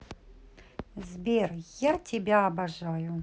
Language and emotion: Russian, positive